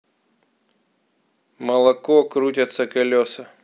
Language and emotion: Russian, neutral